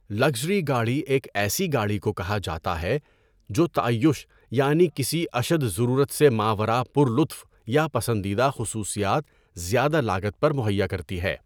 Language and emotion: Urdu, neutral